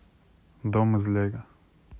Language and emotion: Russian, neutral